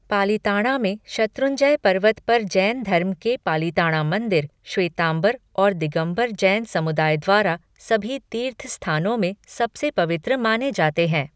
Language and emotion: Hindi, neutral